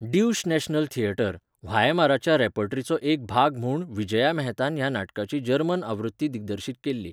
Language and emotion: Goan Konkani, neutral